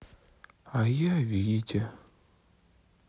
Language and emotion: Russian, sad